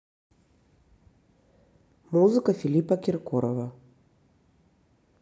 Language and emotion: Russian, neutral